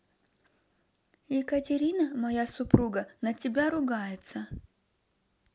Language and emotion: Russian, neutral